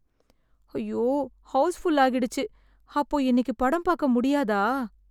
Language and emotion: Tamil, sad